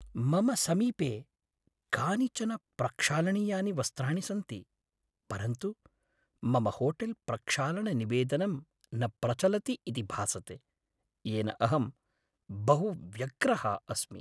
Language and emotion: Sanskrit, sad